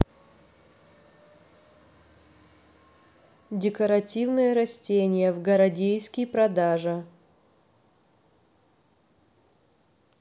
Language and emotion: Russian, neutral